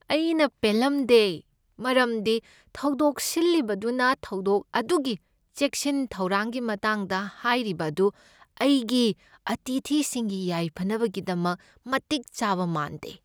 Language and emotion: Manipuri, sad